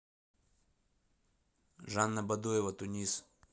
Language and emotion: Russian, neutral